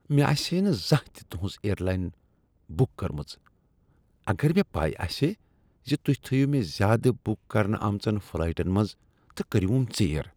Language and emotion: Kashmiri, disgusted